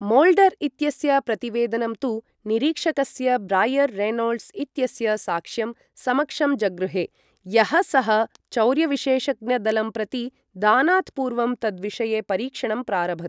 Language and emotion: Sanskrit, neutral